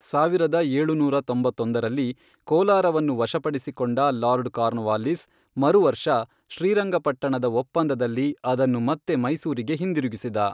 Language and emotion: Kannada, neutral